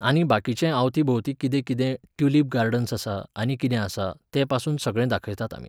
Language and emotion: Goan Konkani, neutral